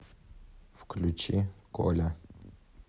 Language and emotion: Russian, neutral